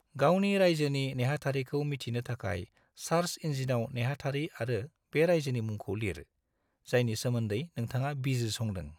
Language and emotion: Bodo, neutral